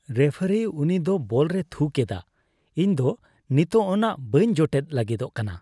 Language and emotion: Santali, disgusted